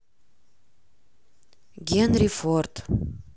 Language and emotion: Russian, neutral